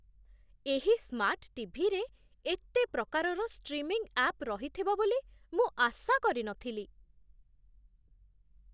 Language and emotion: Odia, surprised